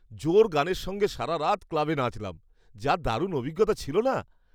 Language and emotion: Bengali, happy